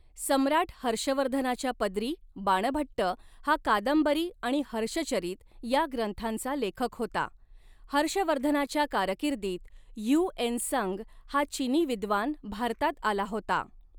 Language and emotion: Marathi, neutral